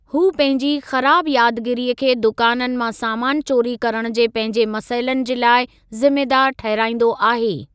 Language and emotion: Sindhi, neutral